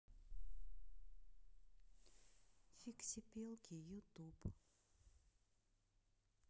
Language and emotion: Russian, sad